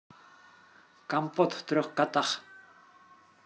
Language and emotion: Russian, positive